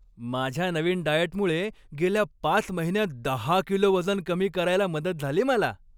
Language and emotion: Marathi, happy